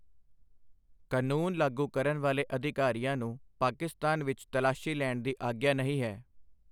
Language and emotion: Punjabi, neutral